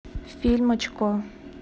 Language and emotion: Russian, neutral